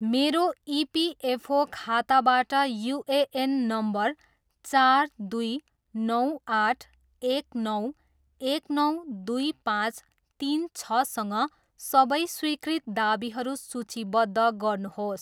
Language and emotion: Nepali, neutral